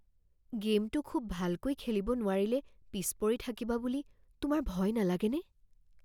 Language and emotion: Assamese, fearful